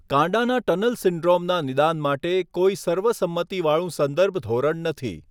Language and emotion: Gujarati, neutral